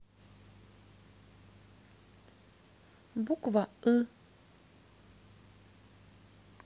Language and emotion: Russian, neutral